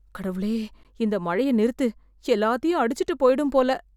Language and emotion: Tamil, fearful